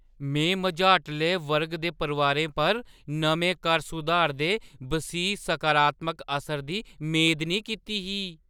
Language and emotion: Dogri, surprised